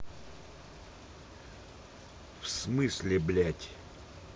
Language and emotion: Russian, angry